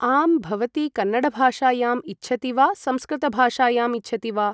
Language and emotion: Sanskrit, neutral